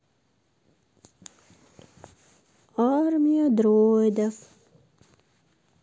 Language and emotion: Russian, sad